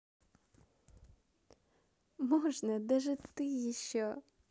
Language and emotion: Russian, positive